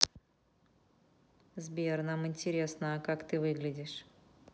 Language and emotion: Russian, neutral